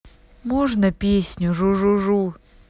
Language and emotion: Russian, sad